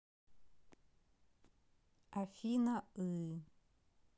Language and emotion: Russian, neutral